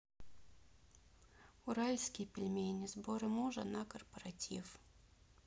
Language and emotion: Russian, neutral